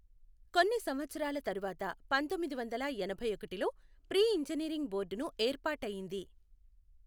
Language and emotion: Telugu, neutral